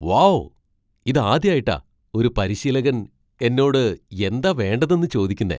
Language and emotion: Malayalam, surprised